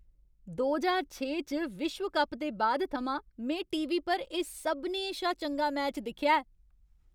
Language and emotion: Dogri, happy